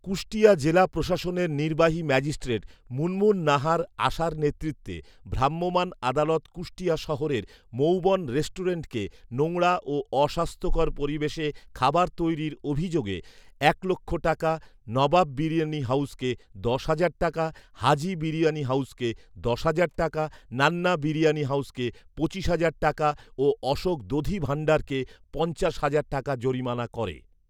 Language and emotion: Bengali, neutral